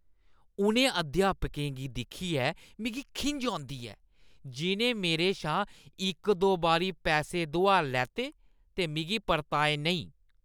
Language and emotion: Dogri, disgusted